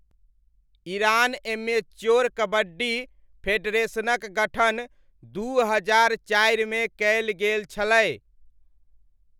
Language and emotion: Maithili, neutral